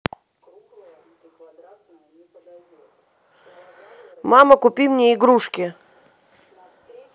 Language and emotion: Russian, positive